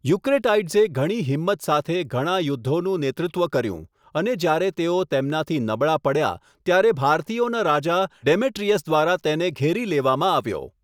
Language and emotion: Gujarati, neutral